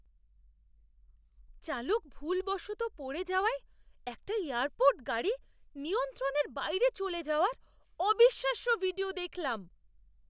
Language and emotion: Bengali, surprised